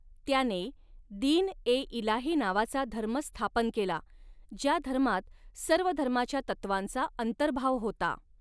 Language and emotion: Marathi, neutral